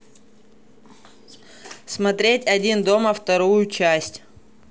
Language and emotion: Russian, neutral